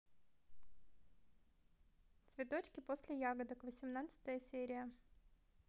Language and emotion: Russian, positive